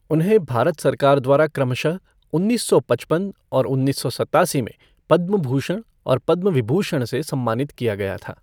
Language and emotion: Hindi, neutral